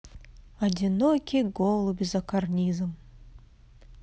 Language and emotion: Russian, positive